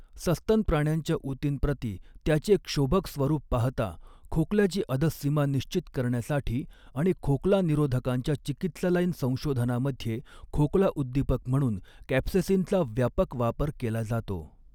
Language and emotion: Marathi, neutral